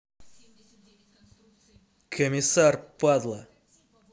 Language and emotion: Russian, angry